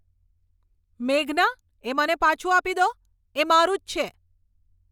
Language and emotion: Gujarati, angry